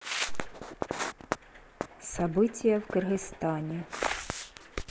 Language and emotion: Russian, neutral